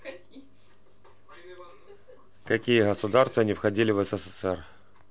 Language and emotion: Russian, neutral